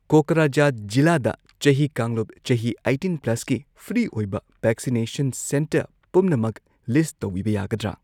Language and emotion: Manipuri, neutral